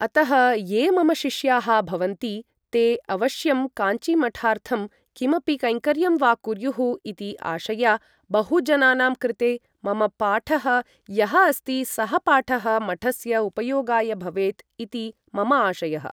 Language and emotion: Sanskrit, neutral